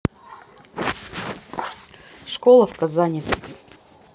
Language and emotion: Russian, neutral